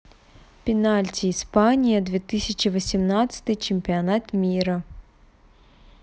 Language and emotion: Russian, neutral